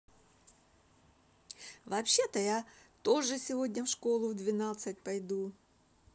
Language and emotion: Russian, positive